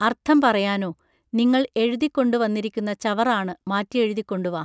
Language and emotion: Malayalam, neutral